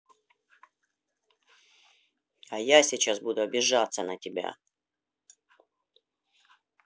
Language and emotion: Russian, angry